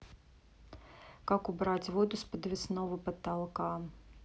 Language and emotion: Russian, neutral